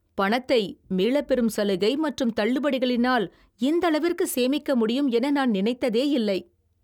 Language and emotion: Tamil, surprised